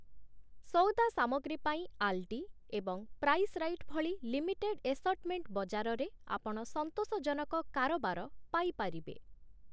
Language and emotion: Odia, neutral